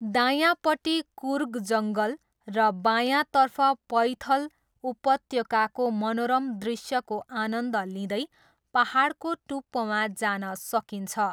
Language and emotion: Nepali, neutral